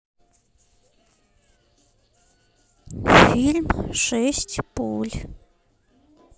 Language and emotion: Russian, neutral